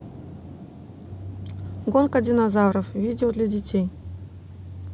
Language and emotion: Russian, neutral